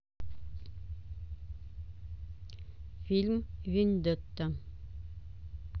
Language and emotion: Russian, neutral